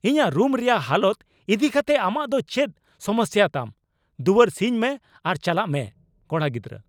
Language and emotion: Santali, angry